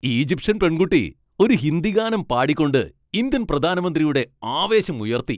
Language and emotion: Malayalam, happy